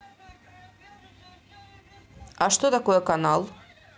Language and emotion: Russian, neutral